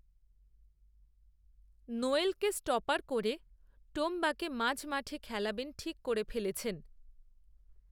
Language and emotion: Bengali, neutral